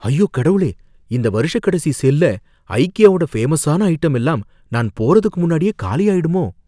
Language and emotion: Tamil, fearful